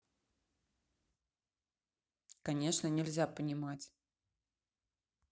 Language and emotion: Russian, neutral